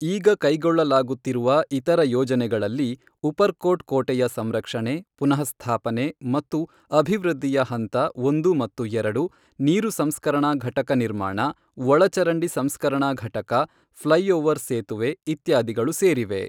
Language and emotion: Kannada, neutral